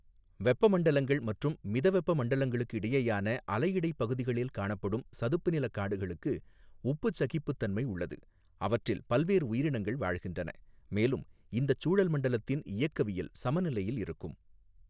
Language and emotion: Tamil, neutral